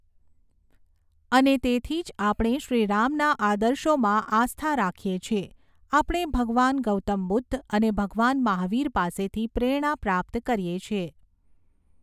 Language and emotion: Gujarati, neutral